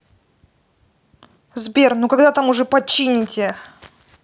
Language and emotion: Russian, angry